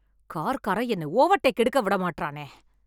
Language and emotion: Tamil, angry